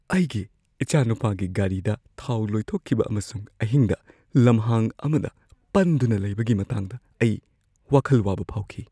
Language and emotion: Manipuri, fearful